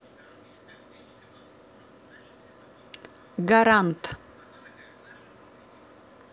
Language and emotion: Russian, neutral